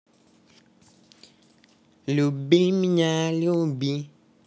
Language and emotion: Russian, positive